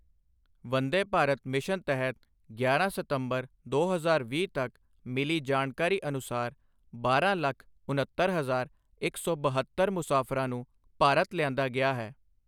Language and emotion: Punjabi, neutral